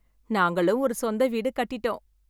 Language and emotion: Tamil, happy